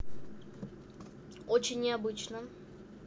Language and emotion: Russian, neutral